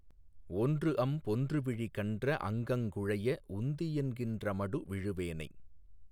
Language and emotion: Tamil, neutral